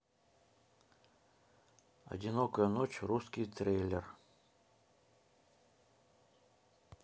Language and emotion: Russian, neutral